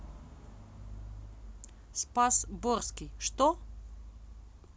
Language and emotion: Russian, neutral